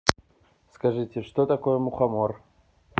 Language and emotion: Russian, neutral